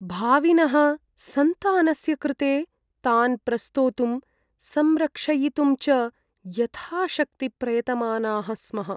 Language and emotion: Sanskrit, sad